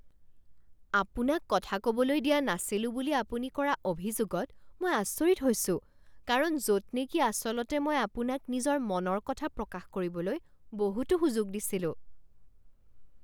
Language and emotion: Assamese, surprised